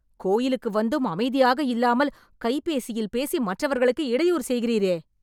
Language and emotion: Tamil, angry